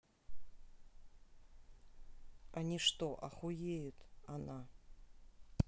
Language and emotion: Russian, neutral